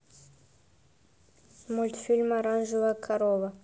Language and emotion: Russian, neutral